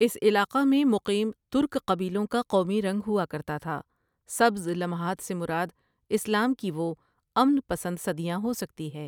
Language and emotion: Urdu, neutral